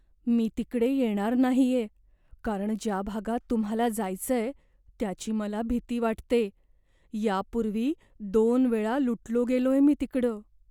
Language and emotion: Marathi, fearful